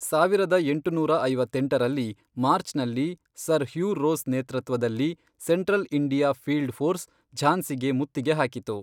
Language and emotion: Kannada, neutral